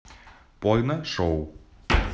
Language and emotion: Russian, neutral